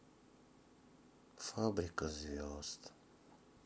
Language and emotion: Russian, sad